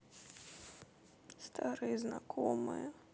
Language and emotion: Russian, sad